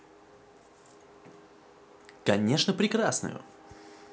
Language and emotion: Russian, positive